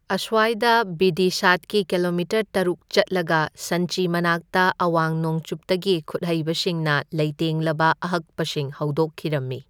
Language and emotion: Manipuri, neutral